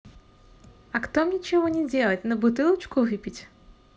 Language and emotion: Russian, positive